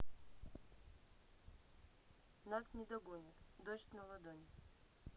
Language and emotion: Russian, neutral